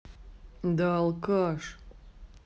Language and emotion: Russian, angry